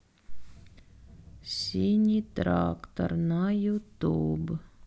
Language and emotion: Russian, neutral